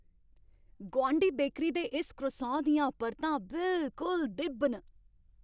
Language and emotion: Dogri, happy